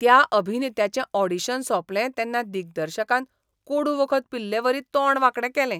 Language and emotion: Goan Konkani, disgusted